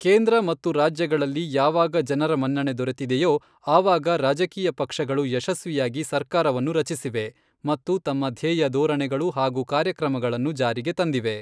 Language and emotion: Kannada, neutral